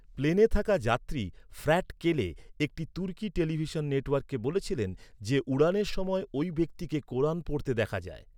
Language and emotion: Bengali, neutral